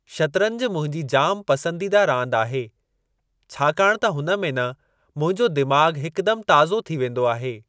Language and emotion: Sindhi, neutral